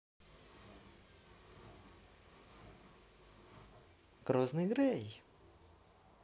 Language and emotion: Russian, positive